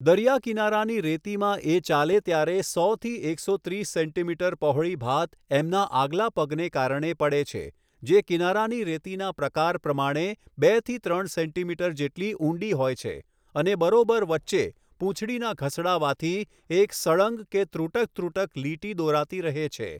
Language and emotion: Gujarati, neutral